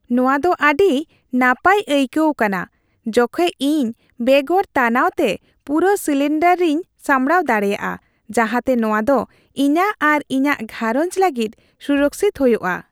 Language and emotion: Santali, happy